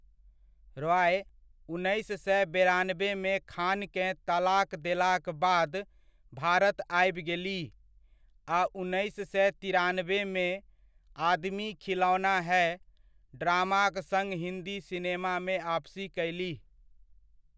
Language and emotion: Maithili, neutral